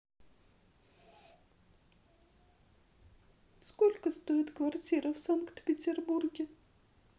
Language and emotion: Russian, sad